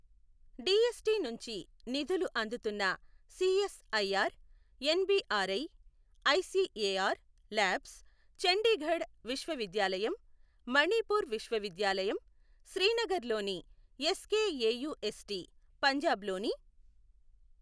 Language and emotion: Telugu, neutral